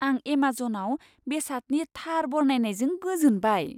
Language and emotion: Bodo, surprised